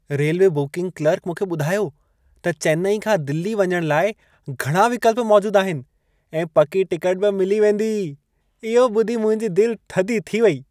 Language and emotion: Sindhi, happy